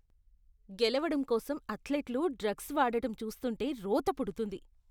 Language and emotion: Telugu, disgusted